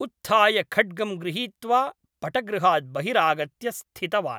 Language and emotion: Sanskrit, neutral